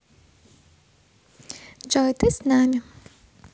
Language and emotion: Russian, positive